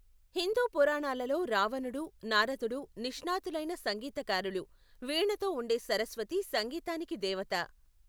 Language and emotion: Telugu, neutral